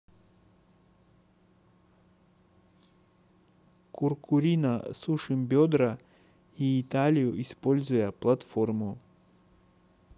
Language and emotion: Russian, neutral